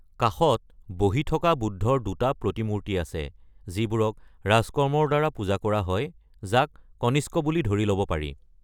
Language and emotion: Assamese, neutral